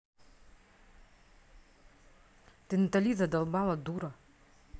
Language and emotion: Russian, angry